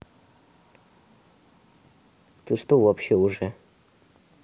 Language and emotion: Russian, neutral